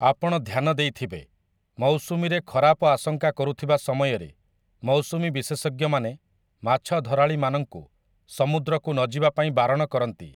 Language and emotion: Odia, neutral